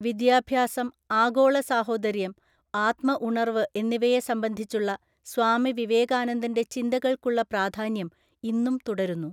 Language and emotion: Malayalam, neutral